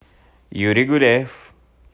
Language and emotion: Russian, positive